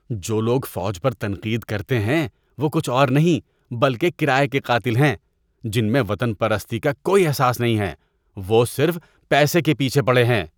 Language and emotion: Urdu, disgusted